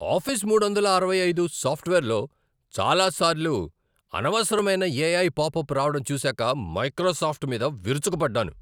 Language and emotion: Telugu, angry